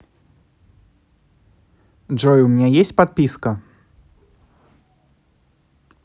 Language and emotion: Russian, neutral